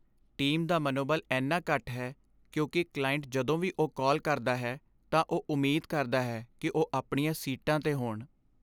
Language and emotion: Punjabi, sad